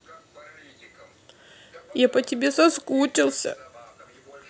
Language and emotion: Russian, sad